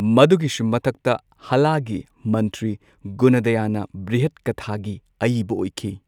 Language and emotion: Manipuri, neutral